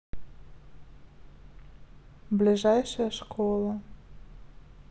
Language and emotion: Russian, neutral